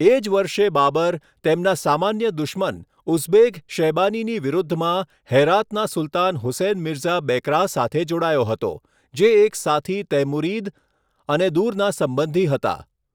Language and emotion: Gujarati, neutral